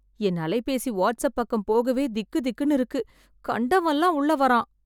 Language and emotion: Tamil, fearful